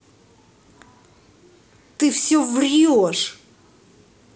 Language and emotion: Russian, angry